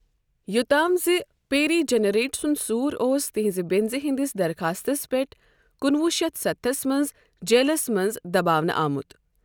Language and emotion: Kashmiri, neutral